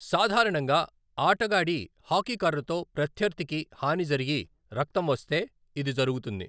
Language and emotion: Telugu, neutral